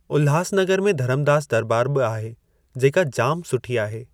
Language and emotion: Sindhi, neutral